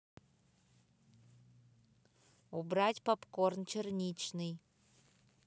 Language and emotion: Russian, neutral